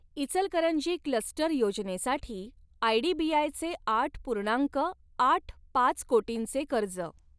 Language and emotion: Marathi, neutral